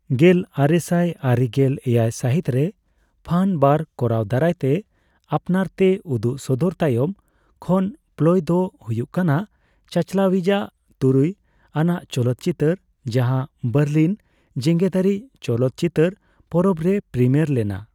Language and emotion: Santali, neutral